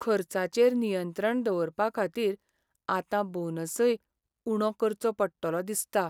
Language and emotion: Goan Konkani, sad